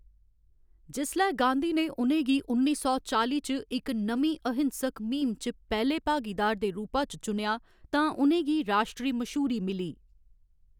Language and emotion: Dogri, neutral